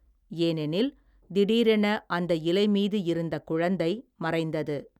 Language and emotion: Tamil, neutral